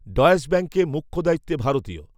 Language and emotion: Bengali, neutral